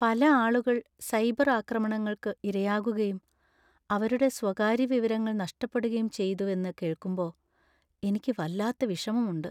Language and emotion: Malayalam, sad